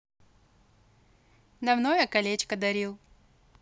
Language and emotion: Russian, neutral